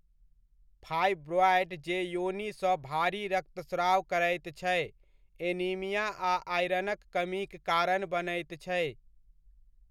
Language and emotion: Maithili, neutral